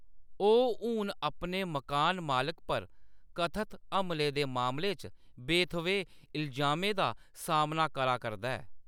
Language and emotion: Dogri, neutral